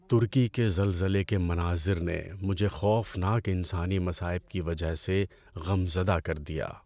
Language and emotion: Urdu, sad